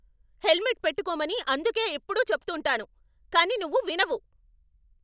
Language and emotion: Telugu, angry